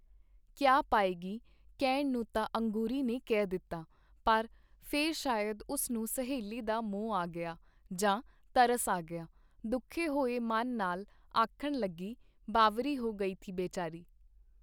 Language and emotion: Punjabi, neutral